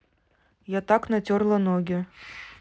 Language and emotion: Russian, neutral